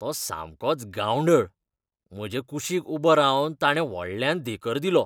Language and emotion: Goan Konkani, disgusted